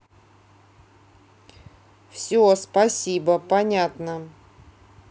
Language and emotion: Russian, neutral